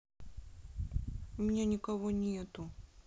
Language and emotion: Russian, sad